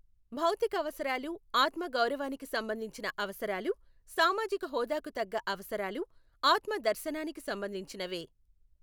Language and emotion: Telugu, neutral